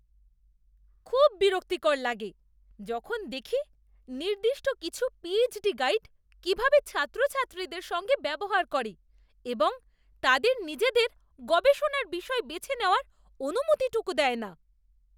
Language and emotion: Bengali, disgusted